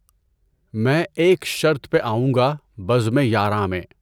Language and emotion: Urdu, neutral